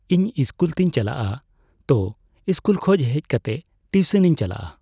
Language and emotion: Santali, neutral